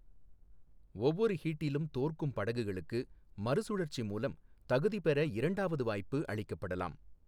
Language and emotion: Tamil, neutral